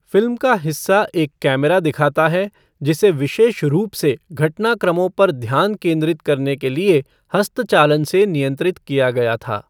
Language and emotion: Hindi, neutral